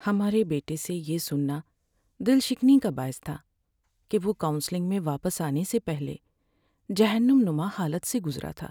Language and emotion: Urdu, sad